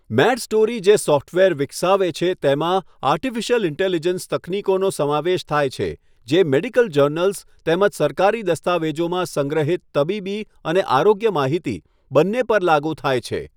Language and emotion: Gujarati, neutral